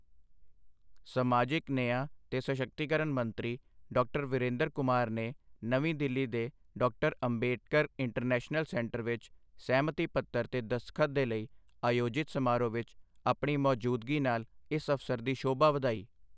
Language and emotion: Punjabi, neutral